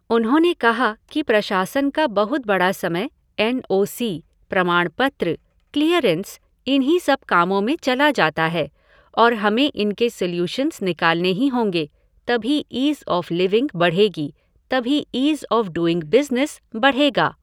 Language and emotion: Hindi, neutral